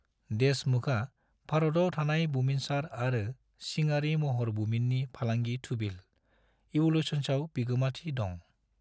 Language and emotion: Bodo, neutral